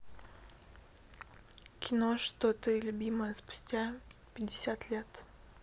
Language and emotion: Russian, neutral